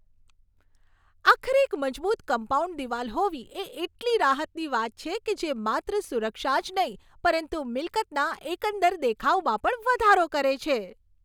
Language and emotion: Gujarati, happy